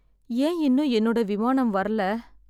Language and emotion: Tamil, sad